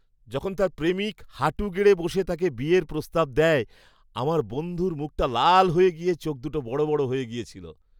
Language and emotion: Bengali, surprised